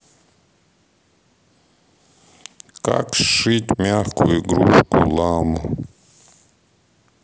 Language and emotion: Russian, neutral